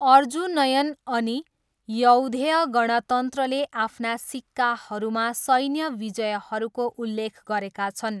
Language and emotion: Nepali, neutral